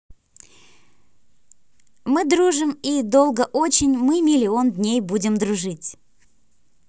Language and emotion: Russian, positive